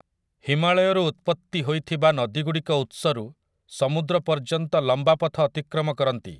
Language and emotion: Odia, neutral